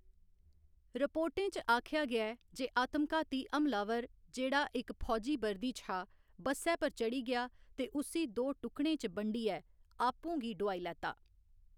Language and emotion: Dogri, neutral